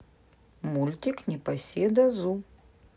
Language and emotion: Russian, neutral